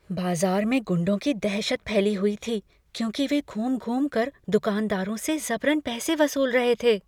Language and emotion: Hindi, fearful